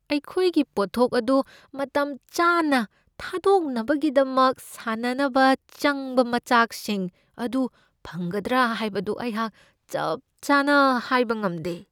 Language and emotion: Manipuri, fearful